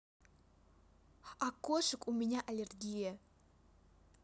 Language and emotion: Russian, neutral